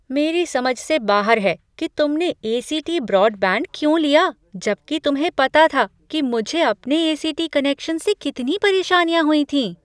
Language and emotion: Hindi, surprised